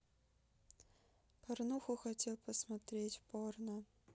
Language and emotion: Russian, sad